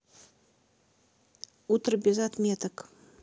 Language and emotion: Russian, neutral